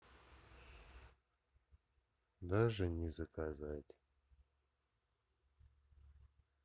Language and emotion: Russian, sad